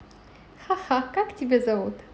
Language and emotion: Russian, positive